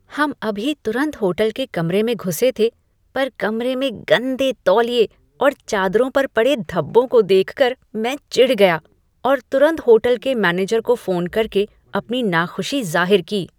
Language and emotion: Hindi, disgusted